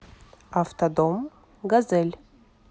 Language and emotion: Russian, neutral